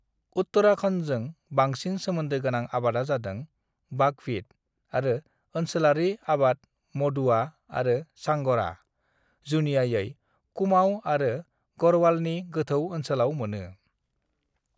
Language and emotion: Bodo, neutral